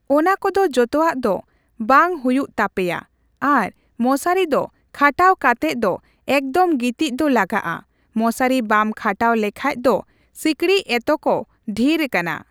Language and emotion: Santali, neutral